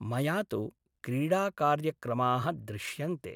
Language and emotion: Sanskrit, neutral